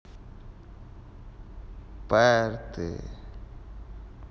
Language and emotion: Russian, neutral